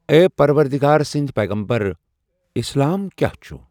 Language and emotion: Kashmiri, neutral